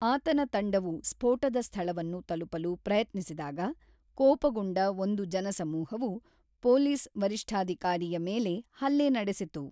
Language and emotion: Kannada, neutral